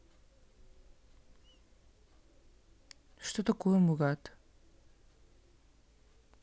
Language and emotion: Russian, neutral